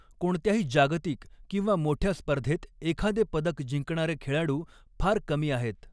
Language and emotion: Marathi, neutral